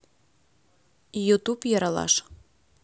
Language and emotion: Russian, neutral